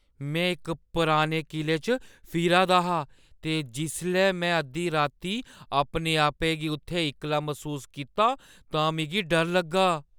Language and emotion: Dogri, fearful